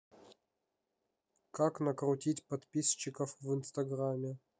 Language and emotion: Russian, neutral